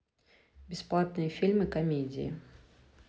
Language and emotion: Russian, neutral